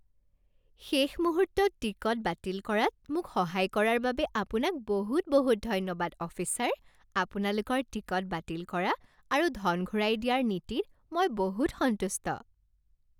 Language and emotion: Assamese, happy